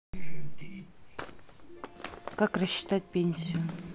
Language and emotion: Russian, neutral